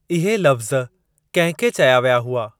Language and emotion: Sindhi, neutral